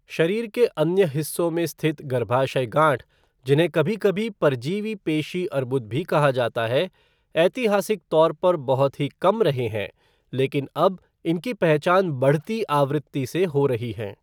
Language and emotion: Hindi, neutral